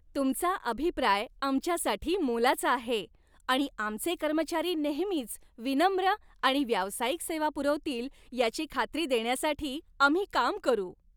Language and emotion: Marathi, happy